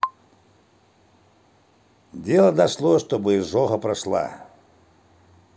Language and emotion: Russian, neutral